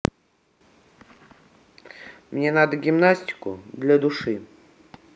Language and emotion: Russian, neutral